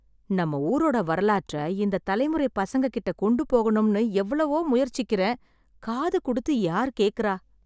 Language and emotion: Tamil, sad